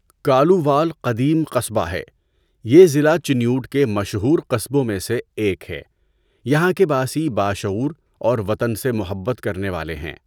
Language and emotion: Urdu, neutral